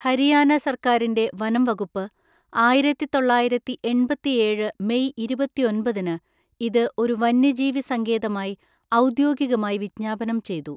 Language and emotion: Malayalam, neutral